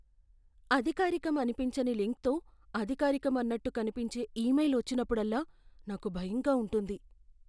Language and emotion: Telugu, fearful